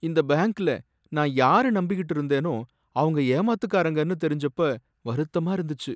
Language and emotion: Tamil, sad